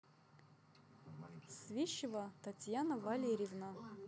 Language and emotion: Russian, neutral